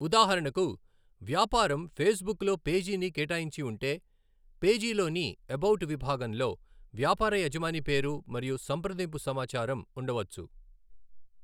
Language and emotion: Telugu, neutral